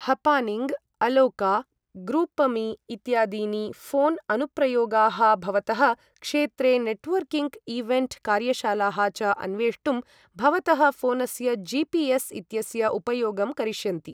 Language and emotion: Sanskrit, neutral